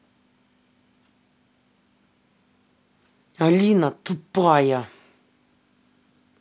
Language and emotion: Russian, angry